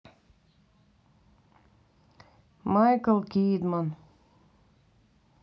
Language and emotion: Russian, neutral